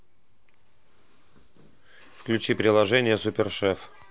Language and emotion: Russian, neutral